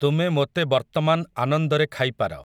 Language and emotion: Odia, neutral